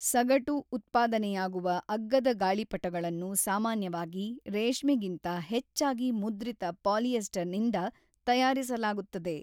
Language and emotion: Kannada, neutral